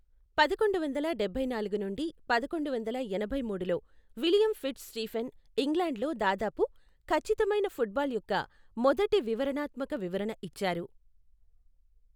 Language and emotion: Telugu, neutral